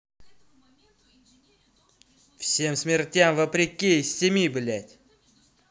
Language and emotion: Russian, angry